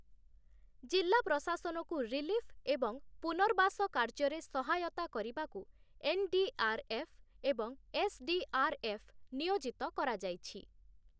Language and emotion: Odia, neutral